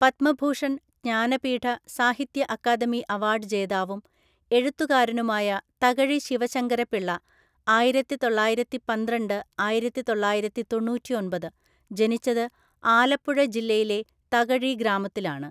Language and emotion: Malayalam, neutral